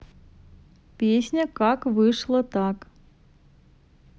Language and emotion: Russian, neutral